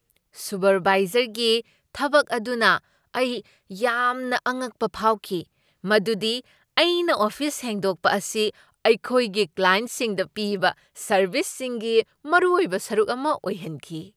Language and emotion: Manipuri, surprised